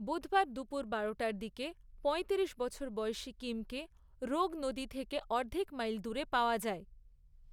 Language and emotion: Bengali, neutral